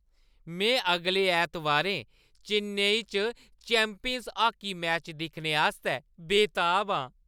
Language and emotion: Dogri, happy